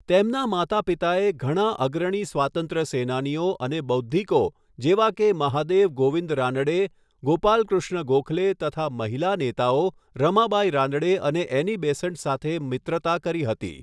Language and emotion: Gujarati, neutral